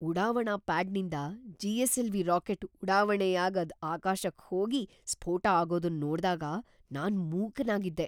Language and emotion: Kannada, surprised